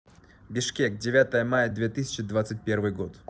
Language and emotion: Russian, neutral